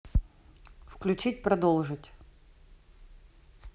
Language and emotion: Russian, neutral